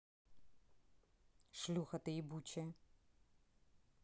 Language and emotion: Russian, angry